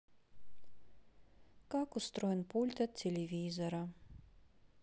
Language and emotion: Russian, neutral